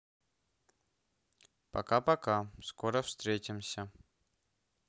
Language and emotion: Russian, neutral